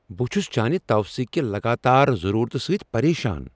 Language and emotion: Kashmiri, angry